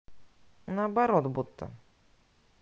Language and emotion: Russian, neutral